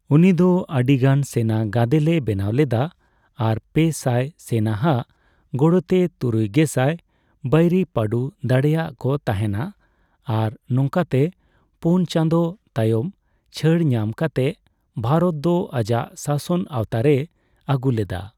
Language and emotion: Santali, neutral